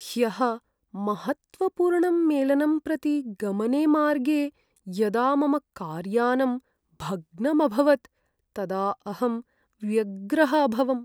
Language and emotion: Sanskrit, sad